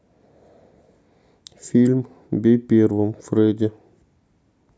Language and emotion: Russian, neutral